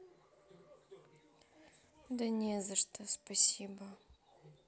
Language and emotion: Russian, sad